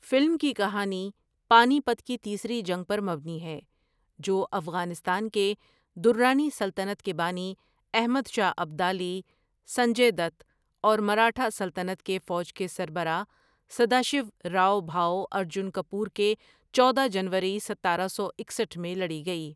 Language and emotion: Urdu, neutral